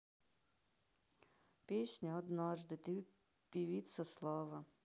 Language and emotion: Russian, sad